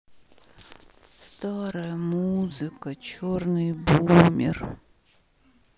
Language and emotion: Russian, sad